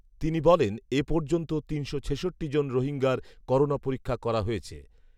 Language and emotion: Bengali, neutral